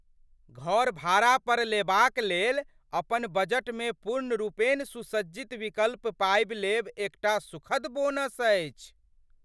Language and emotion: Maithili, surprised